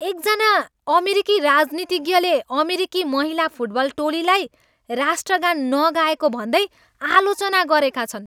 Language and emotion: Nepali, angry